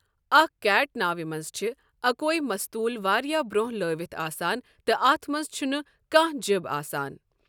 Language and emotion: Kashmiri, neutral